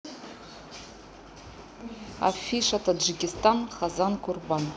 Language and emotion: Russian, neutral